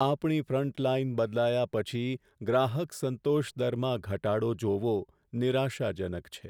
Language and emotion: Gujarati, sad